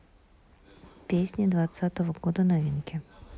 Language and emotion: Russian, neutral